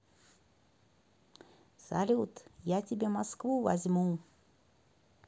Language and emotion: Russian, positive